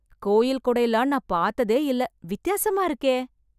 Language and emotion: Tamil, surprised